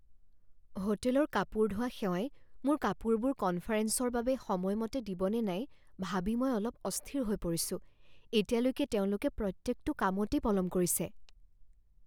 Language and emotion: Assamese, fearful